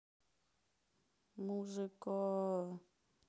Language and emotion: Russian, sad